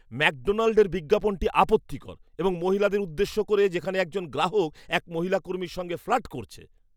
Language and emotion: Bengali, disgusted